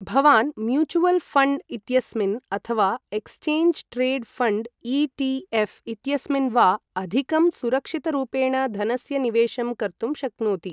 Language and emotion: Sanskrit, neutral